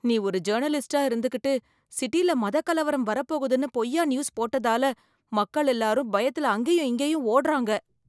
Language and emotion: Tamil, fearful